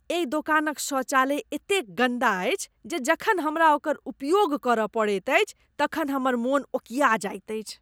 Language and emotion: Maithili, disgusted